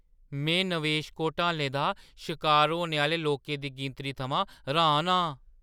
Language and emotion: Dogri, surprised